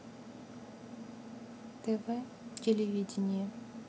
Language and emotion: Russian, neutral